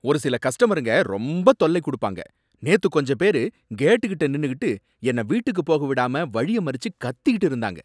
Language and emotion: Tamil, angry